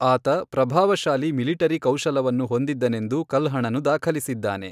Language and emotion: Kannada, neutral